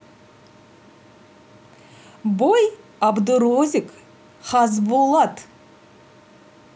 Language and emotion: Russian, positive